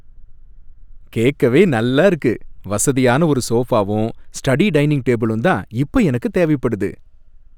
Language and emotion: Tamil, happy